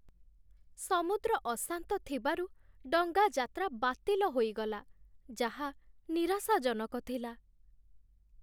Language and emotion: Odia, sad